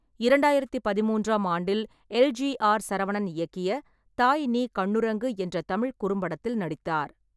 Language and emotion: Tamil, neutral